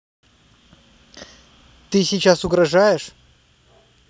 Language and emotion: Russian, angry